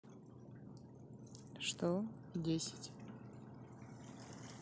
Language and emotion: Russian, neutral